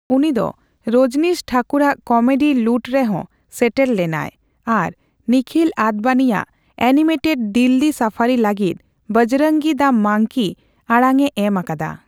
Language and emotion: Santali, neutral